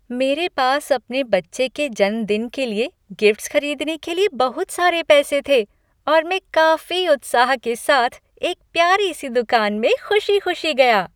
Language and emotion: Hindi, happy